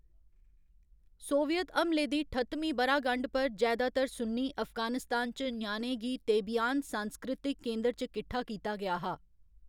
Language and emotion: Dogri, neutral